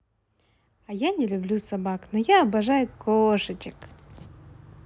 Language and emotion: Russian, positive